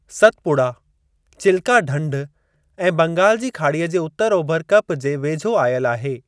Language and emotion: Sindhi, neutral